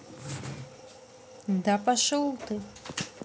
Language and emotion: Russian, neutral